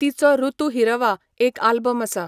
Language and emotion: Goan Konkani, neutral